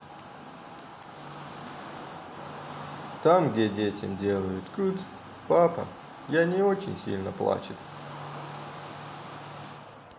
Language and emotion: Russian, sad